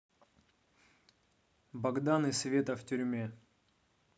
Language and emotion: Russian, neutral